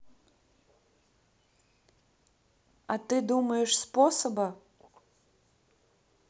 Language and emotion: Russian, neutral